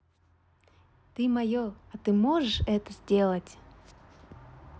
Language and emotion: Russian, positive